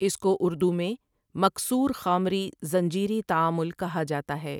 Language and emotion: Urdu, neutral